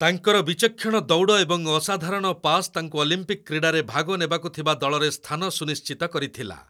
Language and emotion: Odia, neutral